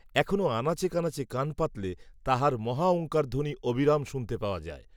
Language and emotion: Bengali, neutral